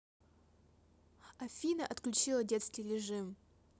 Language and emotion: Russian, neutral